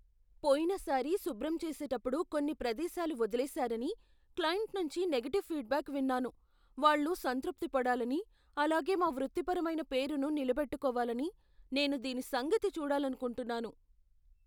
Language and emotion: Telugu, fearful